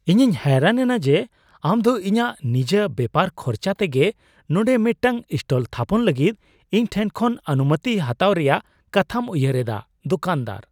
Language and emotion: Santali, surprised